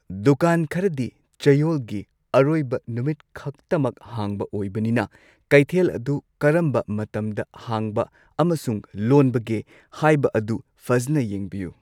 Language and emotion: Manipuri, neutral